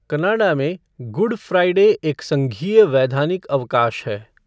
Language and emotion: Hindi, neutral